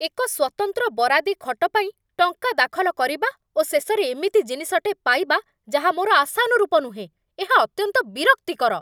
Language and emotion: Odia, angry